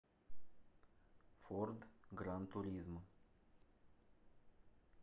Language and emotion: Russian, neutral